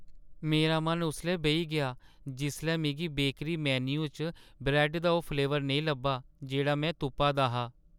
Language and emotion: Dogri, sad